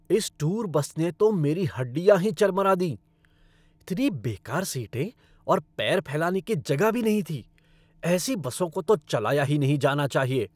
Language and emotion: Hindi, angry